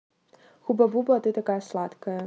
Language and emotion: Russian, neutral